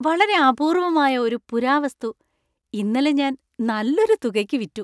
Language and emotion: Malayalam, happy